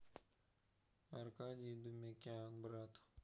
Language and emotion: Russian, neutral